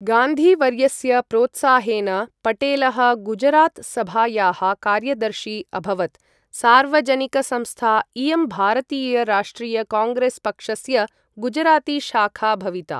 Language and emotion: Sanskrit, neutral